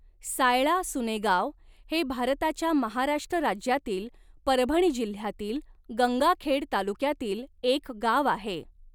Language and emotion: Marathi, neutral